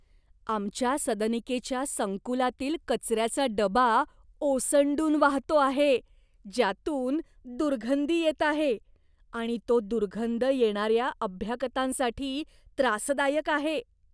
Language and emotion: Marathi, disgusted